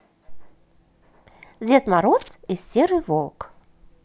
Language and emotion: Russian, positive